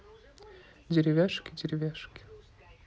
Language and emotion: Russian, neutral